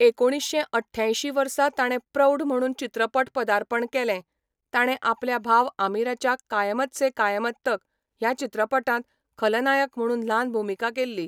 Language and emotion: Goan Konkani, neutral